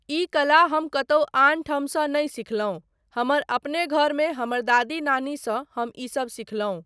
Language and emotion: Maithili, neutral